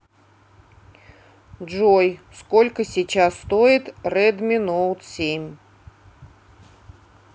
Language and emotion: Russian, neutral